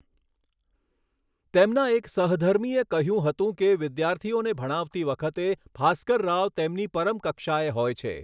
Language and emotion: Gujarati, neutral